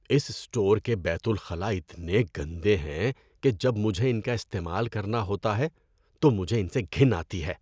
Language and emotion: Urdu, disgusted